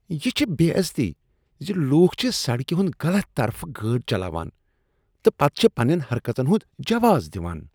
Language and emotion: Kashmiri, disgusted